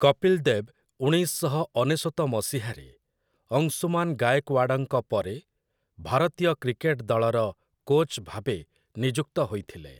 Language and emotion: Odia, neutral